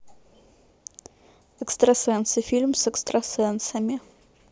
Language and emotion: Russian, neutral